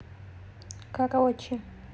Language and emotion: Russian, neutral